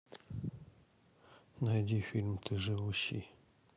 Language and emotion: Russian, sad